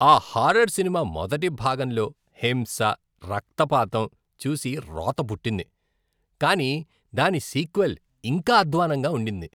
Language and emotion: Telugu, disgusted